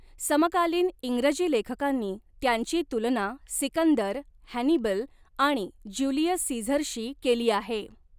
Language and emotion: Marathi, neutral